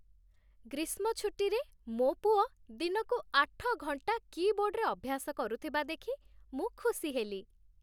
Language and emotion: Odia, happy